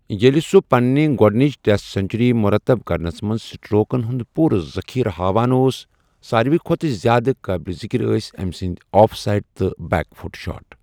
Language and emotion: Kashmiri, neutral